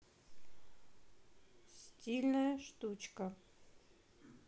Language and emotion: Russian, neutral